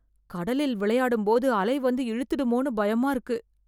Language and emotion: Tamil, fearful